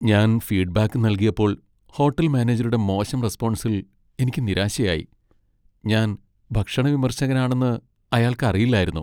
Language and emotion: Malayalam, sad